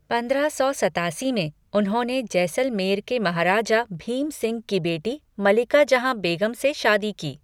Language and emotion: Hindi, neutral